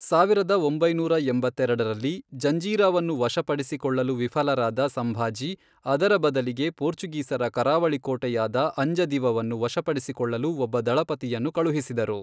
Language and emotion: Kannada, neutral